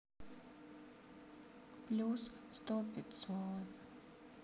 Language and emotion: Russian, sad